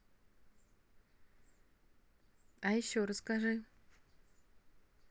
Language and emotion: Russian, neutral